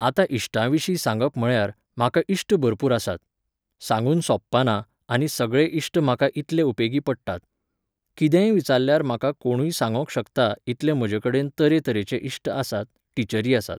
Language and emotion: Goan Konkani, neutral